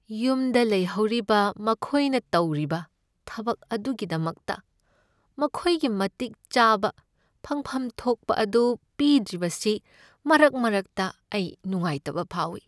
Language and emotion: Manipuri, sad